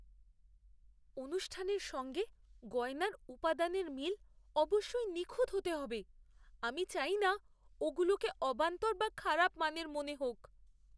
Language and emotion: Bengali, fearful